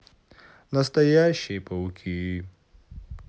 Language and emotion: Russian, sad